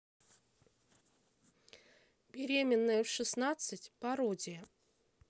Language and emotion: Russian, neutral